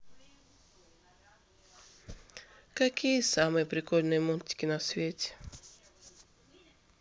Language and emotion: Russian, sad